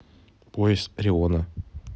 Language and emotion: Russian, neutral